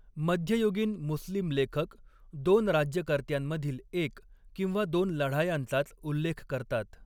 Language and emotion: Marathi, neutral